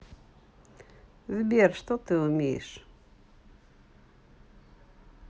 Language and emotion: Russian, neutral